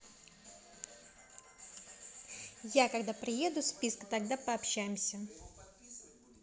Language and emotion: Russian, neutral